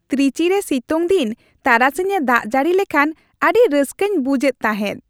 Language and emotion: Santali, happy